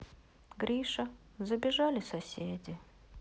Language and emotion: Russian, sad